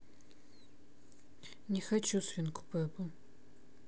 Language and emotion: Russian, sad